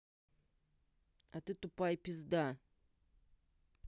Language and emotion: Russian, angry